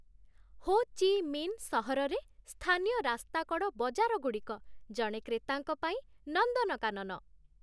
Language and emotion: Odia, happy